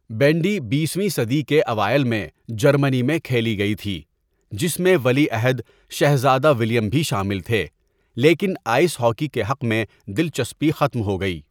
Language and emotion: Urdu, neutral